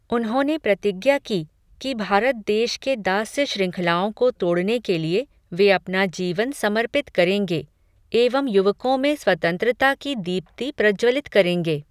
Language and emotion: Hindi, neutral